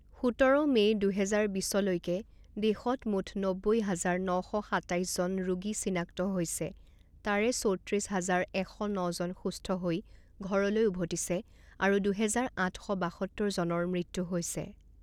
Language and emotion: Assamese, neutral